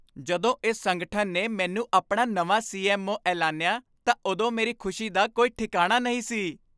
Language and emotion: Punjabi, happy